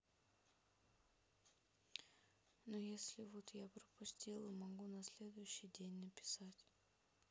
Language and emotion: Russian, sad